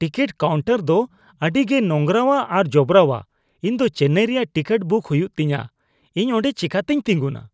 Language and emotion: Santali, disgusted